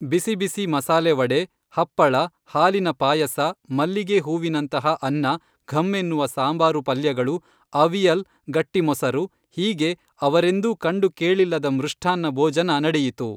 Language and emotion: Kannada, neutral